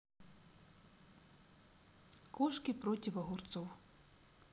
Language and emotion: Russian, neutral